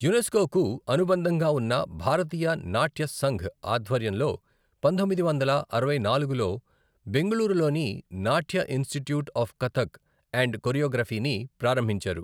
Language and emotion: Telugu, neutral